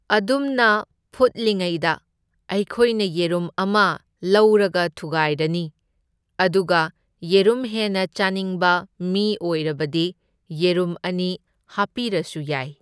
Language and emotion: Manipuri, neutral